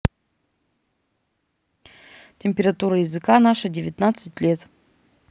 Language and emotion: Russian, neutral